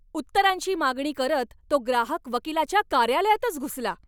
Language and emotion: Marathi, angry